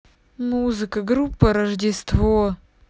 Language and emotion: Russian, sad